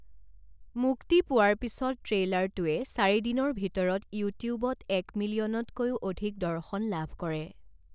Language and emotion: Assamese, neutral